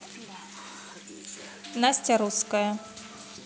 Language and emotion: Russian, neutral